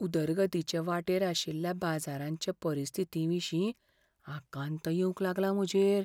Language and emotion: Goan Konkani, fearful